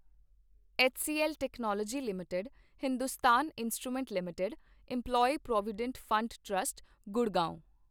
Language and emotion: Punjabi, neutral